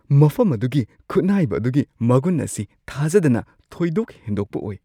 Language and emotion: Manipuri, surprised